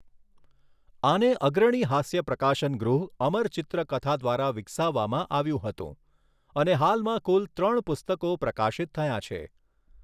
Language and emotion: Gujarati, neutral